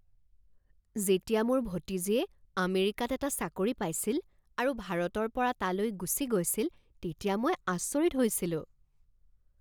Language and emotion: Assamese, surprised